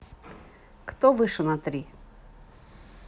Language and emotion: Russian, neutral